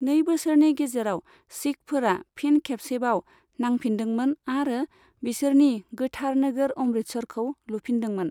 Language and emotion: Bodo, neutral